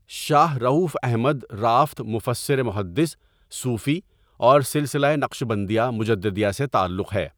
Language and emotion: Urdu, neutral